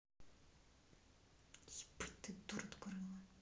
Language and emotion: Russian, angry